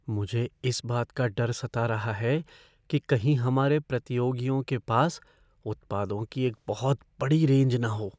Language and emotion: Hindi, fearful